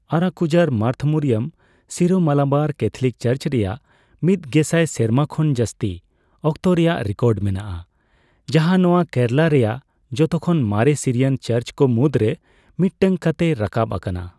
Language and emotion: Santali, neutral